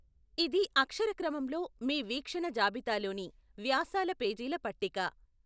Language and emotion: Telugu, neutral